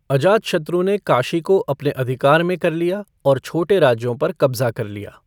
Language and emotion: Hindi, neutral